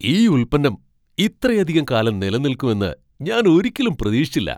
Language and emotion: Malayalam, surprised